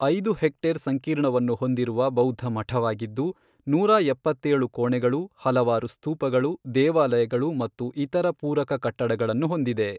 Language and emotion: Kannada, neutral